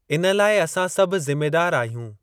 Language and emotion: Sindhi, neutral